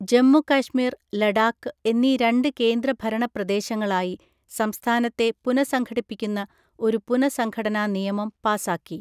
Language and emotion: Malayalam, neutral